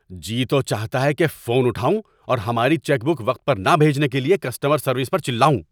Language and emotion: Urdu, angry